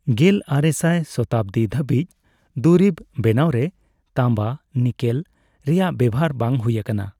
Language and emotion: Santali, neutral